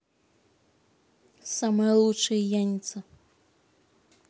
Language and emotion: Russian, angry